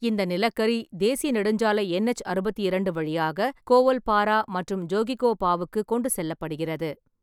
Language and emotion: Tamil, neutral